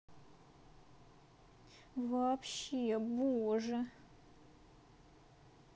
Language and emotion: Russian, sad